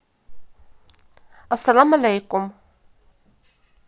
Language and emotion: Russian, neutral